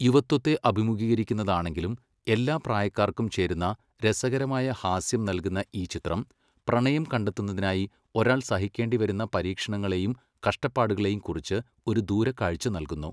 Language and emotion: Malayalam, neutral